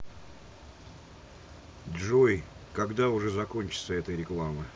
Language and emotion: Russian, neutral